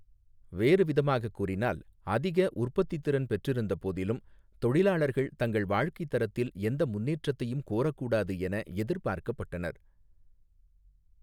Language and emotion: Tamil, neutral